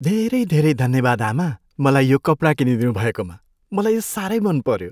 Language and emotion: Nepali, happy